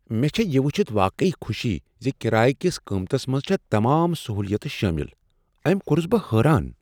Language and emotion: Kashmiri, surprised